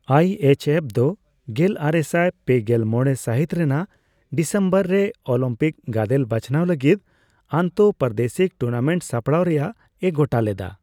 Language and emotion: Santali, neutral